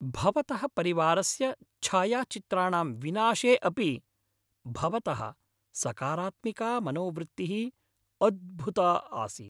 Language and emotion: Sanskrit, happy